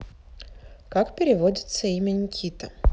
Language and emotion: Russian, neutral